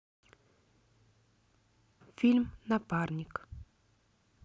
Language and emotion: Russian, neutral